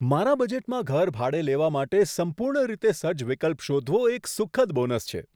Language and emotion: Gujarati, surprised